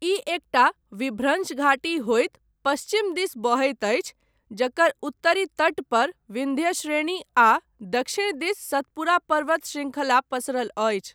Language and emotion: Maithili, neutral